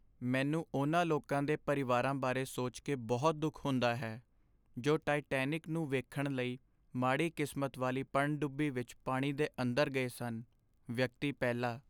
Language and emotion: Punjabi, sad